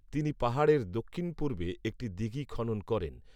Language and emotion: Bengali, neutral